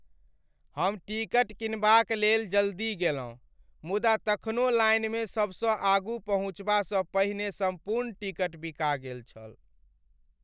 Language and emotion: Maithili, sad